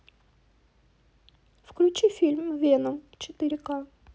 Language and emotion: Russian, neutral